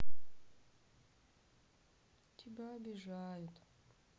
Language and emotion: Russian, sad